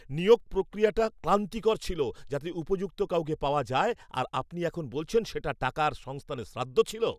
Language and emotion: Bengali, angry